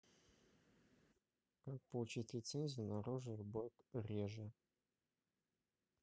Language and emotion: Russian, neutral